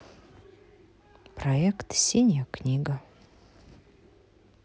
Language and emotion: Russian, neutral